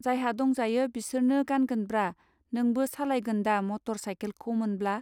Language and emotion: Bodo, neutral